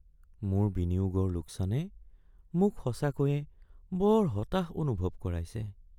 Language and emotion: Assamese, sad